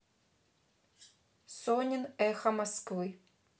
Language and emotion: Russian, neutral